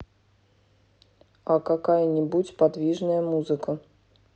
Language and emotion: Russian, neutral